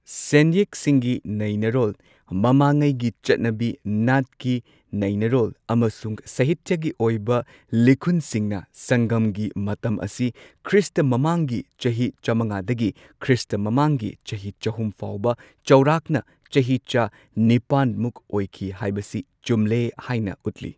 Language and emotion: Manipuri, neutral